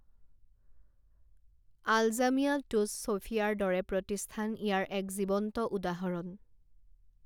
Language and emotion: Assamese, neutral